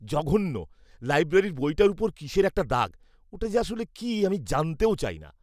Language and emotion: Bengali, disgusted